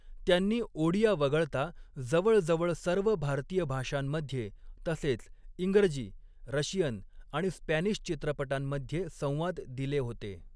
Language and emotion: Marathi, neutral